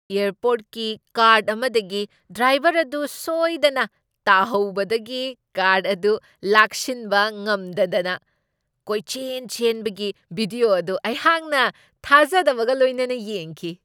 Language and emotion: Manipuri, surprised